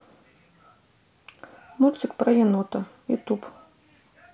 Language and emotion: Russian, neutral